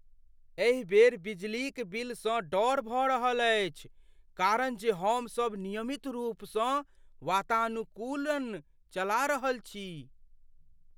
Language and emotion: Maithili, fearful